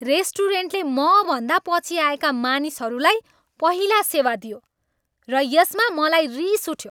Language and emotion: Nepali, angry